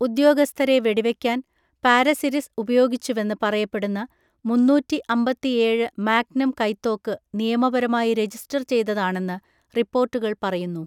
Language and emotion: Malayalam, neutral